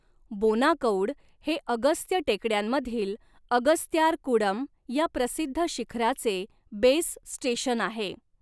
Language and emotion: Marathi, neutral